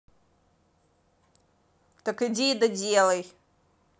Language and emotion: Russian, angry